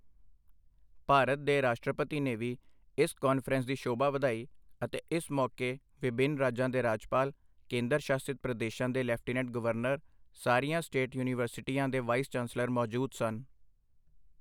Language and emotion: Punjabi, neutral